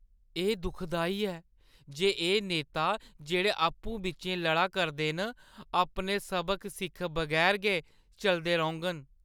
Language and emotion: Dogri, sad